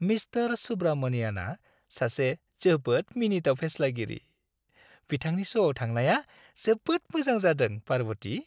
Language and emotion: Bodo, happy